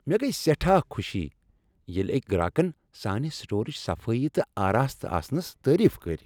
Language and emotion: Kashmiri, happy